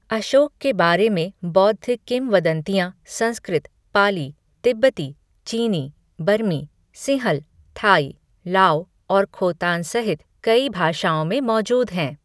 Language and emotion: Hindi, neutral